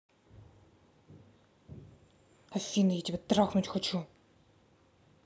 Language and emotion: Russian, angry